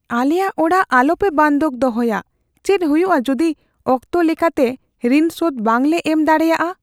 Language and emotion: Santali, fearful